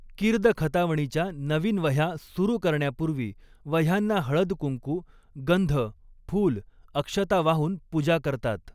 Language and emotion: Marathi, neutral